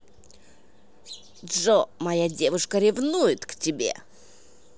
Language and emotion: Russian, angry